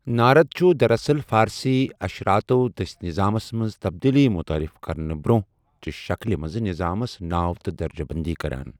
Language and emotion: Kashmiri, neutral